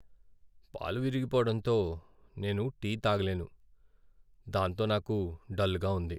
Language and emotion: Telugu, sad